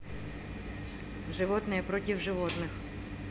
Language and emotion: Russian, neutral